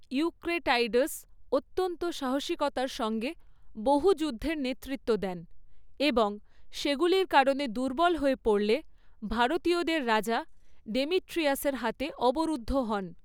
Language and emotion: Bengali, neutral